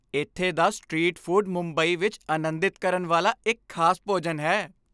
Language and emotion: Punjabi, happy